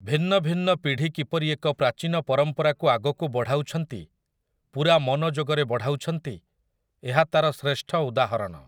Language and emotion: Odia, neutral